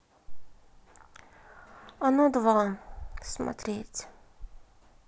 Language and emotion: Russian, sad